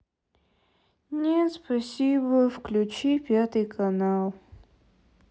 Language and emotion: Russian, sad